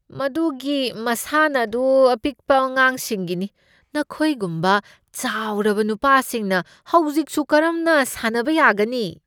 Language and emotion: Manipuri, disgusted